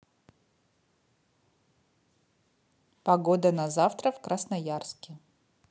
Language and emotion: Russian, neutral